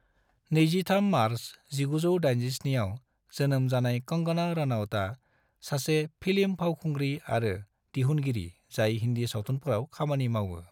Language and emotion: Bodo, neutral